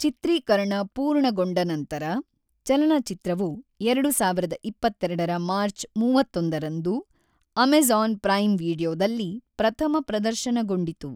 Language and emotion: Kannada, neutral